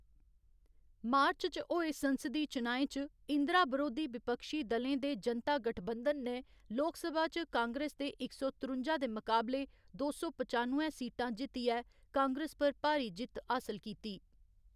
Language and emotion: Dogri, neutral